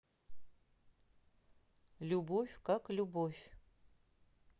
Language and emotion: Russian, neutral